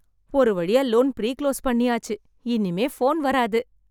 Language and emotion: Tamil, happy